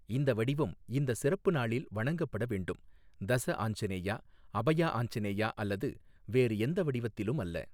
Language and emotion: Tamil, neutral